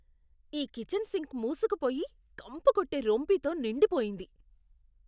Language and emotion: Telugu, disgusted